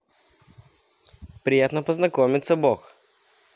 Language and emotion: Russian, positive